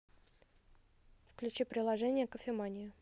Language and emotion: Russian, neutral